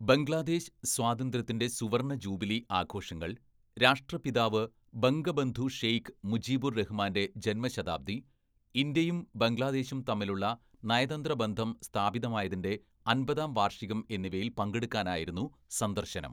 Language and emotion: Malayalam, neutral